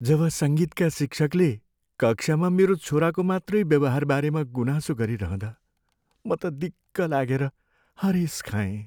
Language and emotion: Nepali, sad